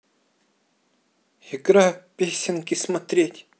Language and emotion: Russian, neutral